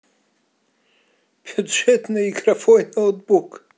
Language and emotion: Russian, positive